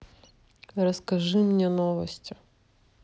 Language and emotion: Russian, neutral